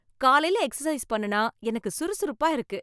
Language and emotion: Tamil, happy